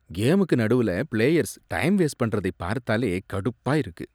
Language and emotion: Tamil, disgusted